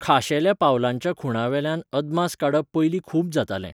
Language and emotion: Goan Konkani, neutral